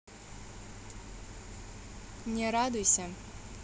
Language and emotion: Russian, neutral